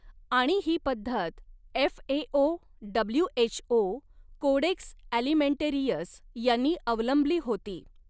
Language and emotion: Marathi, neutral